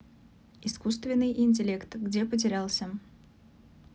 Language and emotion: Russian, neutral